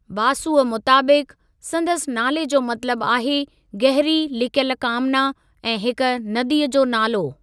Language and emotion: Sindhi, neutral